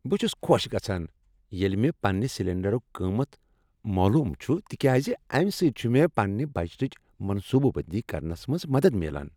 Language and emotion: Kashmiri, happy